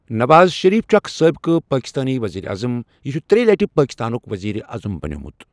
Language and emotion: Kashmiri, neutral